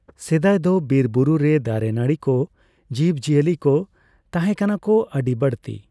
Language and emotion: Santali, neutral